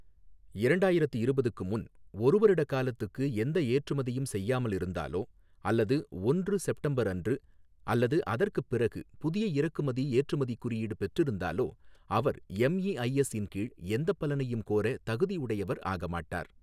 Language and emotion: Tamil, neutral